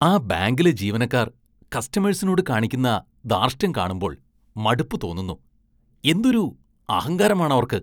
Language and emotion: Malayalam, disgusted